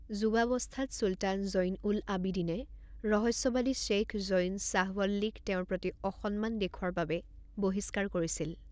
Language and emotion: Assamese, neutral